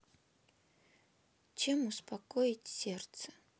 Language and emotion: Russian, sad